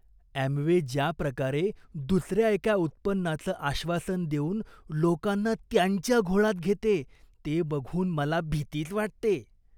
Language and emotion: Marathi, disgusted